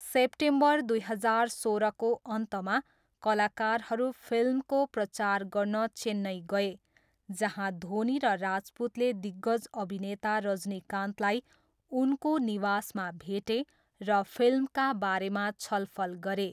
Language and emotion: Nepali, neutral